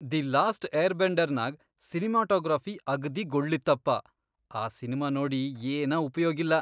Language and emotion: Kannada, disgusted